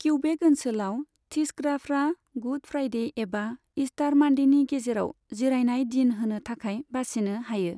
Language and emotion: Bodo, neutral